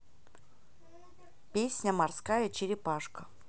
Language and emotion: Russian, neutral